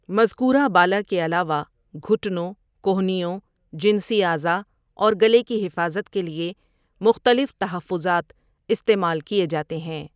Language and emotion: Urdu, neutral